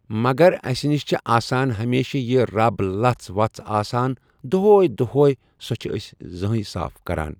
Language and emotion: Kashmiri, neutral